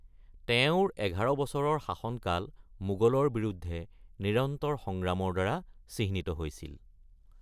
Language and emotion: Assamese, neutral